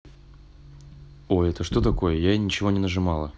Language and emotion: Russian, neutral